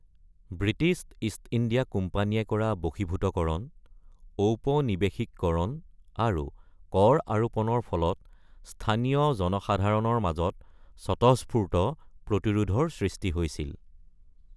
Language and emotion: Assamese, neutral